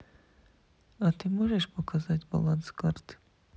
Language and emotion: Russian, neutral